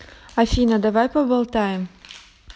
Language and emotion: Russian, neutral